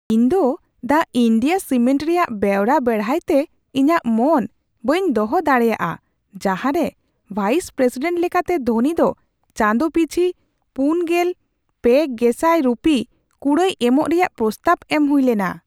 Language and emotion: Santali, surprised